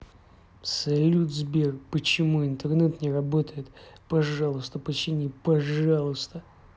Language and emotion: Russian, angry